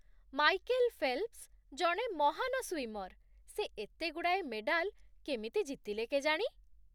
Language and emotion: Odia, surprised